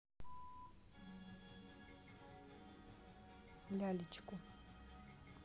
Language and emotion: Russian, neutral